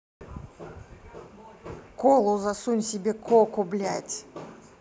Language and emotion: Russian, angry